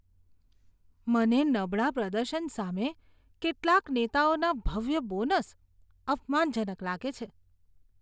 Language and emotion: Gujarati, disgusted